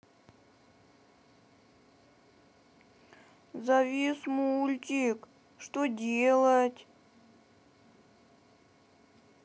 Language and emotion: Russian, sad